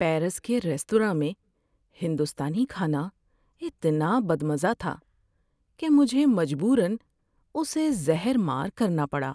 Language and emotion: Urdu, sad